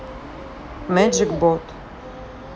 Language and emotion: Russian, neutral